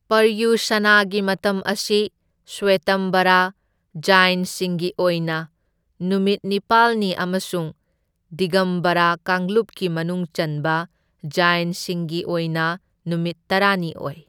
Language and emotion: Manipuri, neutral